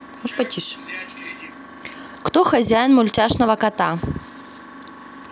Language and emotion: Russian, positive